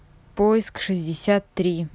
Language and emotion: Russian, neutral